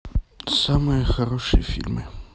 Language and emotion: Russian, neutral